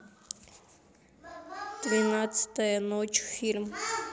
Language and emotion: Russian, neutral